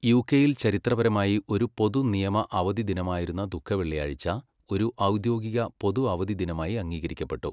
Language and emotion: Malayalam, neutral